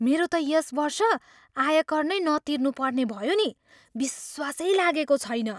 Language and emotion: Nepali, surprised